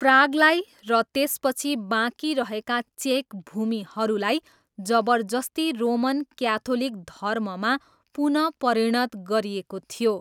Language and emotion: Nepali, neutral